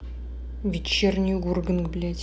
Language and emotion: Russian, angry